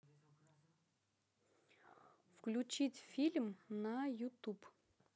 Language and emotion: Russian, neutral